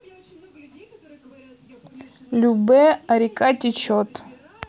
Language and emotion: Russian, neutral